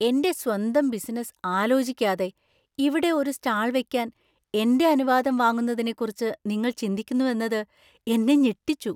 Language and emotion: Malayalam, surprised